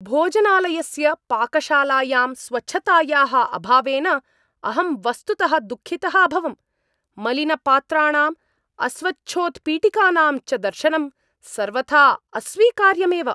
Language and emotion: Sanskrit, angry